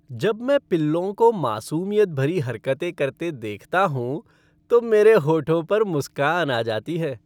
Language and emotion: Hindi, happy